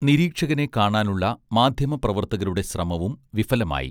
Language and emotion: Malayalam, neutral